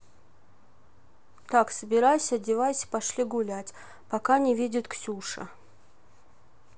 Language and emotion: Russian, neutral